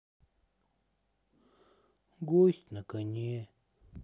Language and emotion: Russian, sad